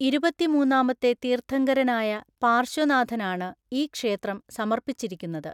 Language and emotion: Malayalam, neutral